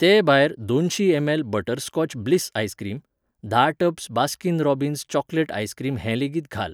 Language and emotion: Goan Konkani, neutral